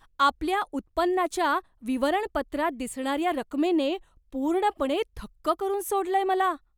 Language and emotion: Marathi, surprised